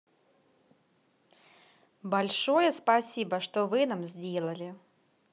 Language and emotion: Russian, positive